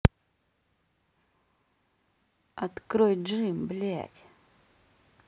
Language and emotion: Russian, angry